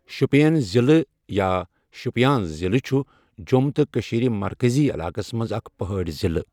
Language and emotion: Kashmiri, neutral